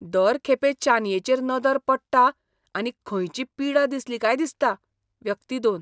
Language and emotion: Goan Konkani, disgusted